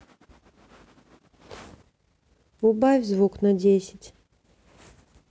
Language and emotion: Russian, neutral